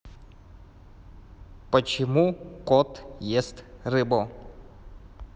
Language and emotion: Russian, neutral